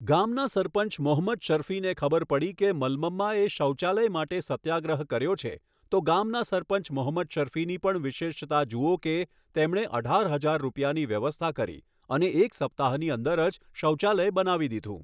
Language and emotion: Gujarati, neutral